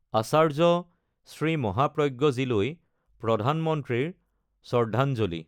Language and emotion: Assamese, neutral